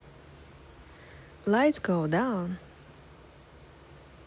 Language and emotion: Russian, positive